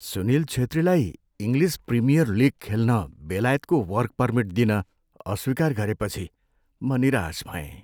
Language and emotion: Nepali, sad